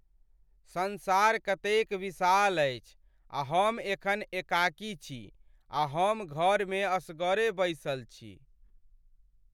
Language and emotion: Maithili, sad